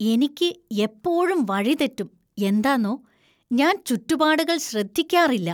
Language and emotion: Malayalam, disgusted